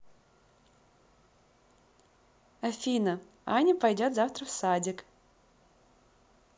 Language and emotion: Russian, positive